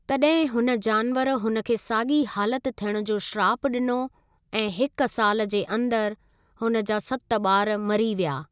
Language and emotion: Sindhi, neutral